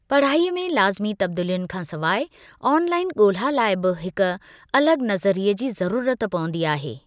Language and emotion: Sindhi, neutral